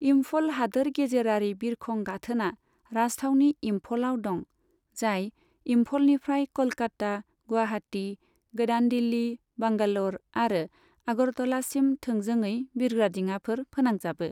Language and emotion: Bodo, neutral